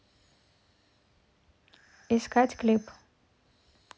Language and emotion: Russian, neutral